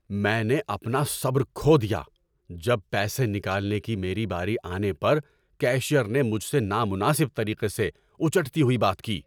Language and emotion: Urdu, angry